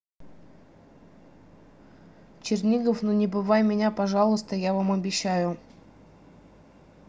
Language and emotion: Russian, neutral